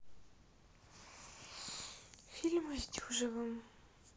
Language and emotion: Russian, sad